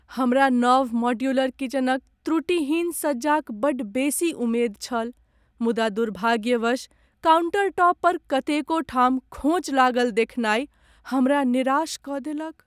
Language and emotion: Maithili, sad